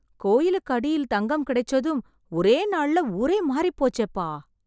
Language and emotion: Tamil, surprised